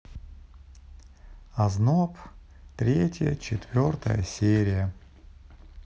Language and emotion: Russian, neutral